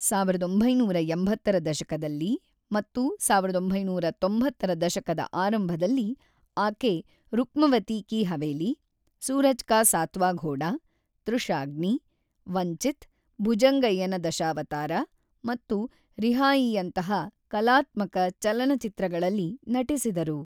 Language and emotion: Kannada, neutral